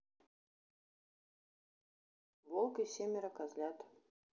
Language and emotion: Russian, neutral